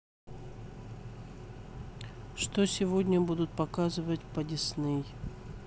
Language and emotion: Russian, neutral